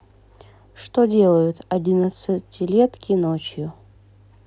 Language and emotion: Russian, neutral